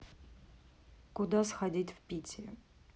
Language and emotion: Russian, neutral